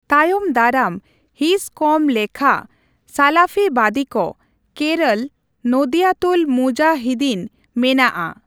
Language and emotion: Santali, neutral